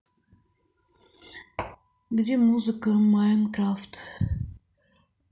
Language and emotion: Russian, neutral